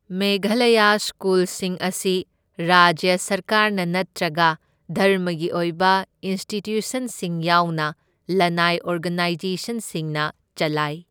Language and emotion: Manipuri, neutral